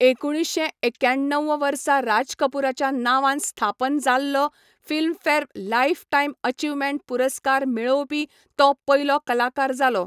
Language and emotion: Goan Konkani, neutral